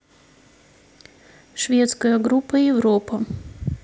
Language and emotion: Russian, neutral